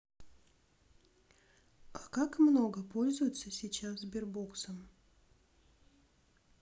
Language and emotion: Russian, neutral